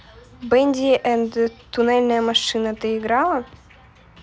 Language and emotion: Russian, neutral